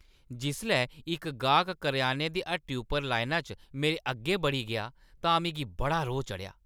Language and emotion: Dogri, angry